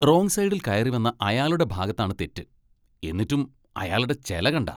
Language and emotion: Malayalam, disgusted